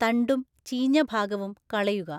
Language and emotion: Malayalam, neutral